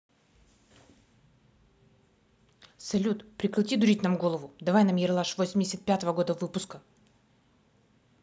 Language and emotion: Russian, angry